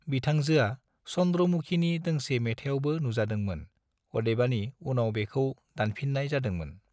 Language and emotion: Bodo, neutral